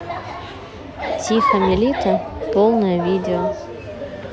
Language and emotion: Russian, neutral